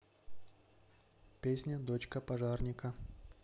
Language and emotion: Russian, neutral